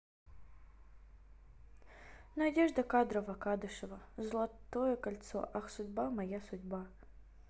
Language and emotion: Russian, sad